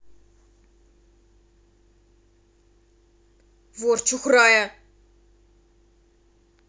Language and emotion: Russian, angry